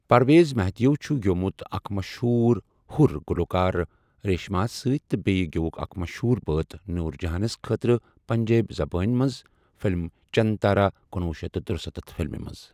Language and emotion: Kashmiri, neutral